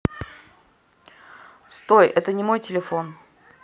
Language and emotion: Russian, neutral